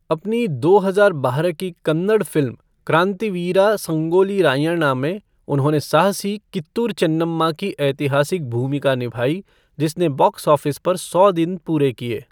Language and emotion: Hindi, neutral